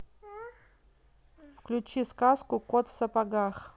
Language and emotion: Russian, neutral